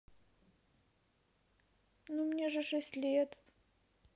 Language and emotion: Russian, sad